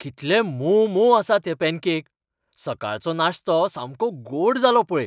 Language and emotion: Goan Konkani, happy